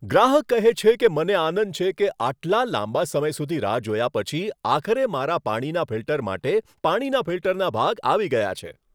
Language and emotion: Gujarati, happy